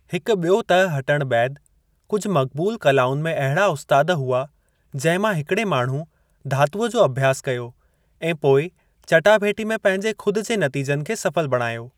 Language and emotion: Sindhi, neutral